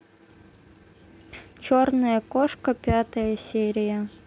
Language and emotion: Russian, neutral